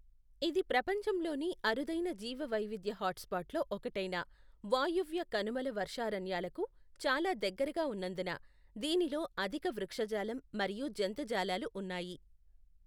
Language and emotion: Telugu, neutral